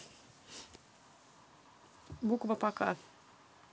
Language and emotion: Russian, neutral